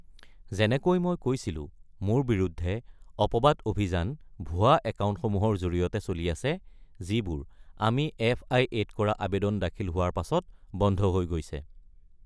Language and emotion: Assamese, neutral